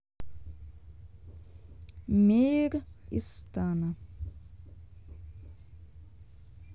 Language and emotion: Russian, neutral